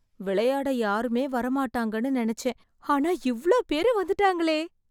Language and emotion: Tamil, surprised